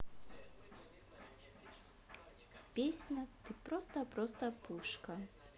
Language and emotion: Russian, neutral